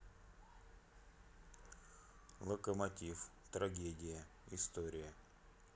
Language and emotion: Russian, neutral